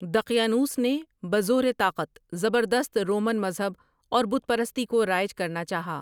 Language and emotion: Urdu, neutral